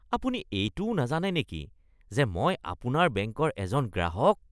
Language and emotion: Assamese, disgusted